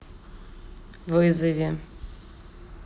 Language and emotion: Russian, neutral